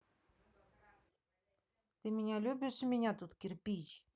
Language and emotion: Russian, neutral